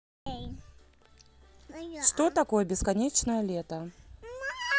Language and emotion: Russian, neutral